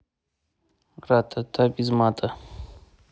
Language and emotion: Russian, neutral